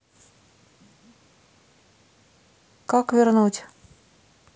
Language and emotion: Russian, neutral